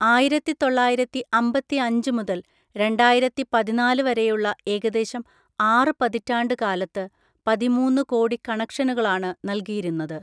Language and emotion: Malayalam, neutral